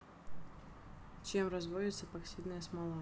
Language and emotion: Russian, neutral